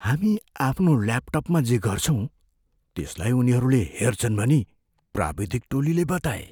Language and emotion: Nepali, fearful